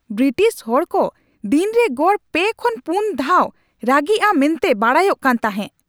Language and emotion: Santali, angry